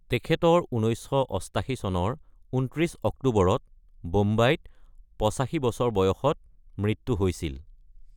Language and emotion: Assamese, neutral